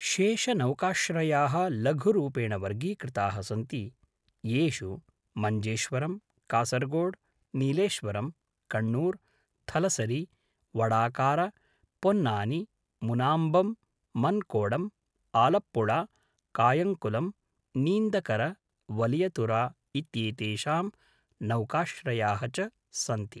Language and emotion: Sanskrit, neutral